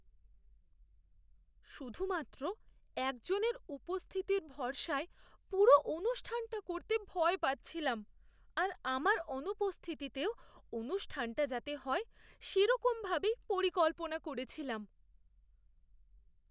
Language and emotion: Bengali, fearful